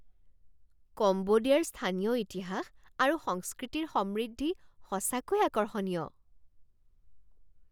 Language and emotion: Assamese, surprised